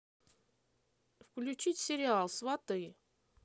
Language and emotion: Russian, neutral